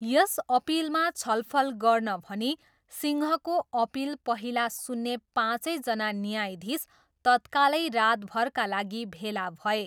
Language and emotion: Nepali, neutral